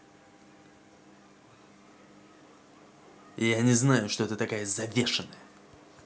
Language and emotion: Russian, angry